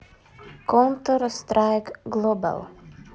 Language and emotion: Russian, neutral